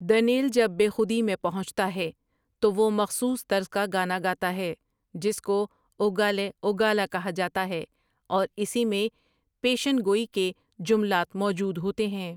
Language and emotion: Urdu, neutral